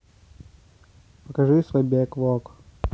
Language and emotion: Russian, neutral